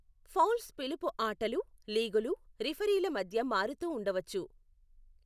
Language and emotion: Telugu, neutral